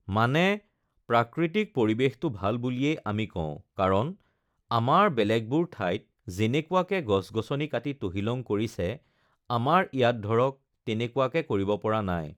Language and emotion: Assamese, neutral